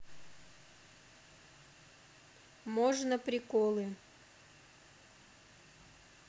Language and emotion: Russian, neutral